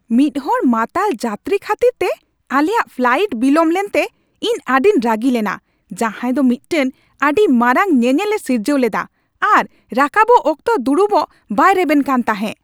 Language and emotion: Santali, angry